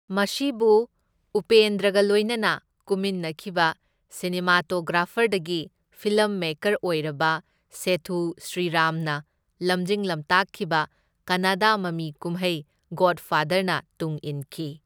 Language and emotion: Manipuri, neutral